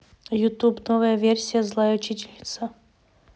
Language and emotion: Russian, neutral